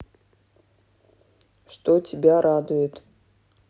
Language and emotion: Russian, neutral